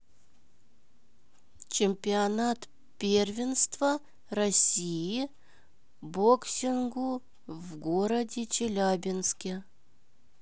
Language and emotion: Russian, neutral